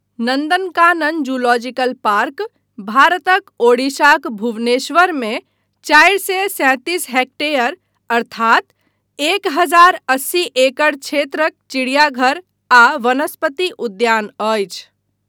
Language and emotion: Maithili, neutral